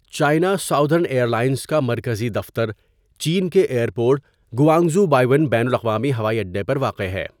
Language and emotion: Urdu, neutral